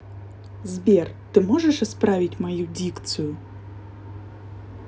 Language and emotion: Russian, neutral